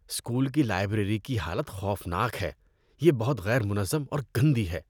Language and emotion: Urdu, disgusted